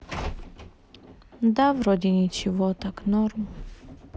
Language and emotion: Russian, sad